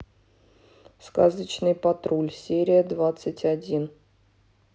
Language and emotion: Russian, neutral